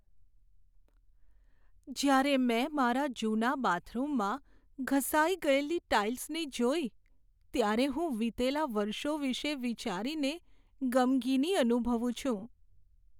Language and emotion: Gujarati, sad